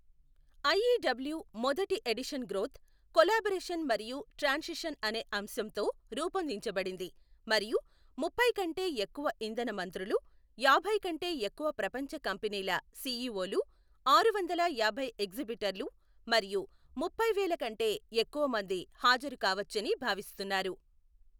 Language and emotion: Telugu, neutral